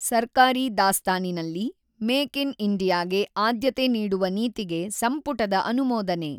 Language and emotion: Kannada, neutral